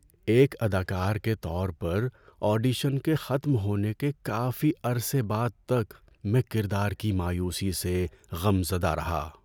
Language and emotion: Urdu, sad